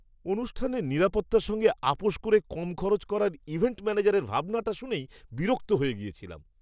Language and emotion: Bengali, disgusted